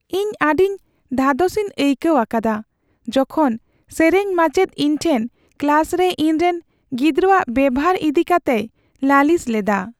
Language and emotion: Santali, sad